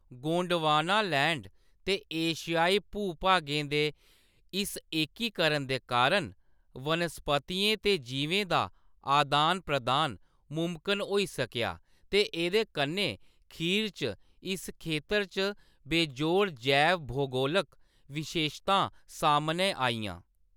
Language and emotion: Dogri, neutral